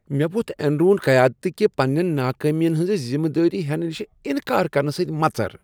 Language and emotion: Kashmiri, disgusted